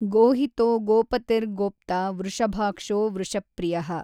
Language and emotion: Kannada, neutral